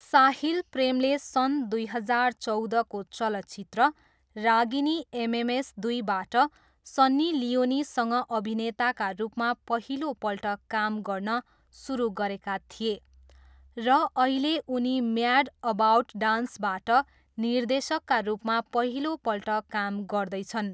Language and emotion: Nepali, neutral